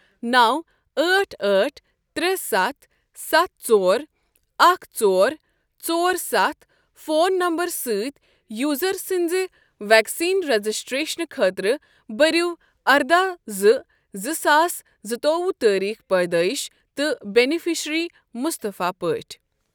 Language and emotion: Kashmiri, neutral